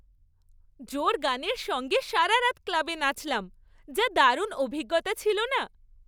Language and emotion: Bengali, happy